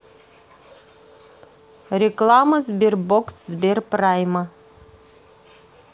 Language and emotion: Russian, neutral